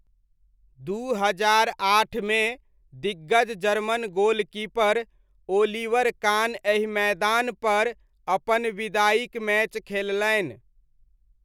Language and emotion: Maithili, neutral